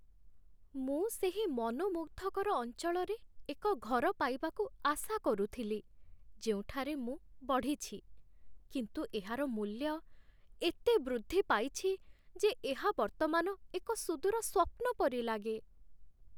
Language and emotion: Odia, sad